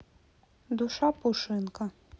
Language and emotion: Russian, neutral